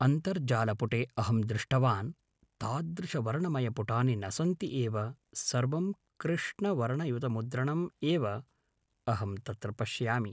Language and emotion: Sanskrit, neutral